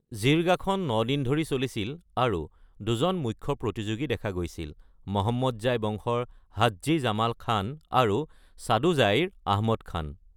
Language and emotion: Assamese, neutral